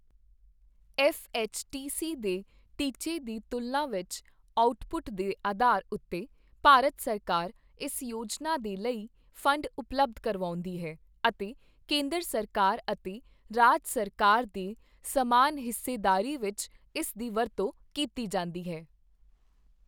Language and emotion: Punjabi, neutral